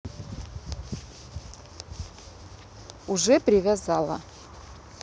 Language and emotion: Russian, neutral